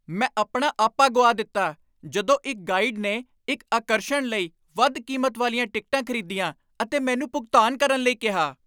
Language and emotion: Punjabi, angry